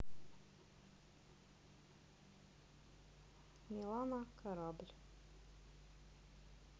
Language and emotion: Russian, neutral